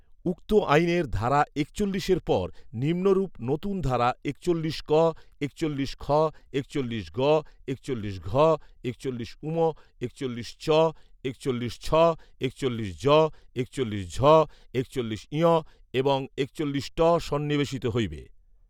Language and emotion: Bengali, neutral